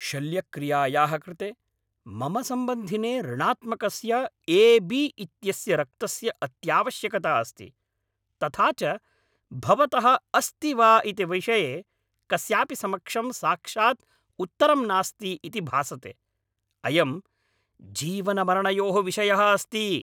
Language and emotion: Sanskrit, angry